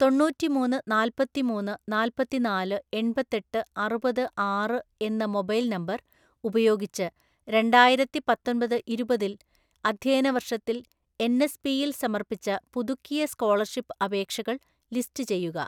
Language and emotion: Malayalam, neutral